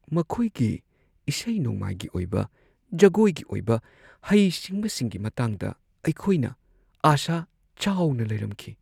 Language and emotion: Manipuri, sad